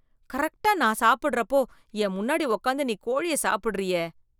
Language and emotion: Tamil, disgusted